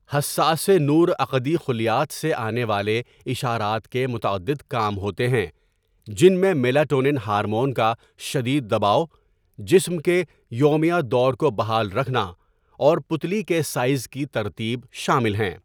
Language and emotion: Urdu, neutral